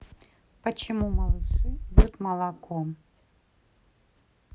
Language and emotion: Russian, neutral